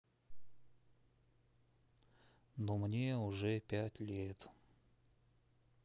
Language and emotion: Russian, sad